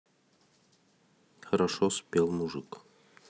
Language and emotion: Russian, neutral